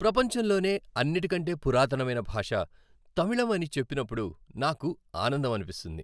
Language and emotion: Telugu, happy